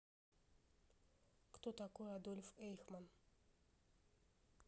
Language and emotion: Russian, neutral